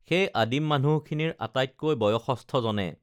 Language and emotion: Assamese, neutral